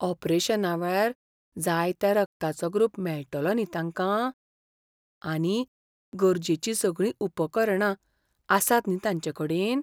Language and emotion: Goan Konkani, fearful